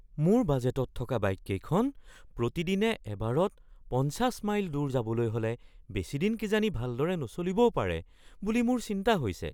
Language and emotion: Assamese, fearful